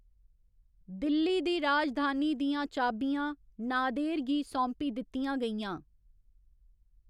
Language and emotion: Dogri, neutral